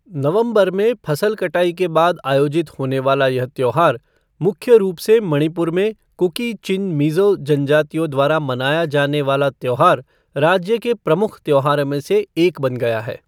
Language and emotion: Hindi, neutral